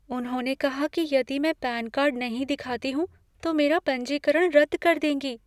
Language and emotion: Hindi, fearful